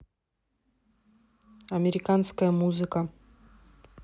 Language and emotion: Russian, neutral